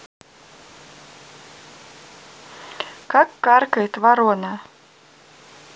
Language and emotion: Russian, neutral